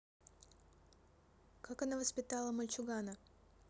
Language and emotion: Russian, neutral